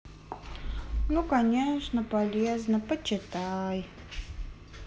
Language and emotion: Russian, sad